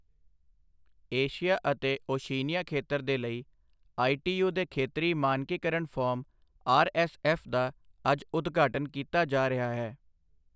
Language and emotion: Punjabi, neutral